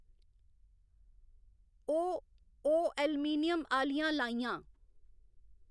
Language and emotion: Dogri, neutral